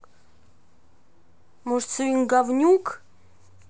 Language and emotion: Russian, angry